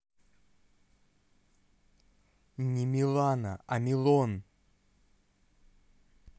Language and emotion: Russian, angry